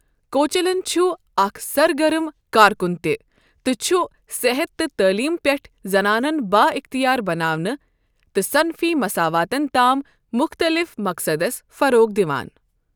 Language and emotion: Kashmiri, neutral